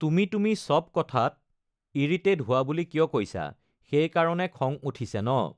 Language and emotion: Assamese, neutral